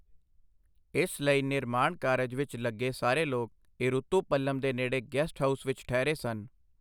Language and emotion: Punjabi, neutral